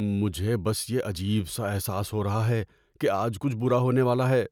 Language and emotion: Urdu, fearful